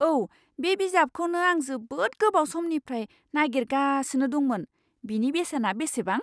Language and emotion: Bodo, surprised